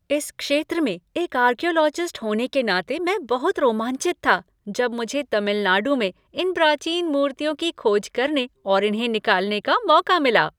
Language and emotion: Hindi, happy